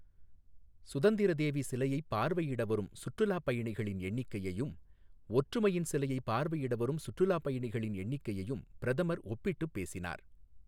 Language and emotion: Tamil, neutral